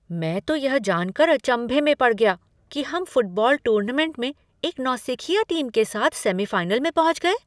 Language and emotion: Hindi, surprised